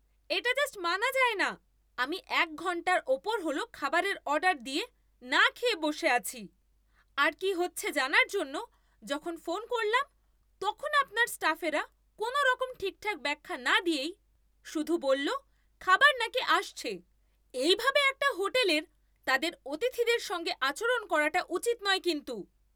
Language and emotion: Bengali, angry